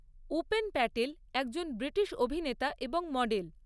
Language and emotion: Bengali, neutral